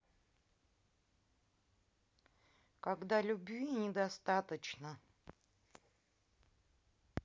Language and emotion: Russian, neutral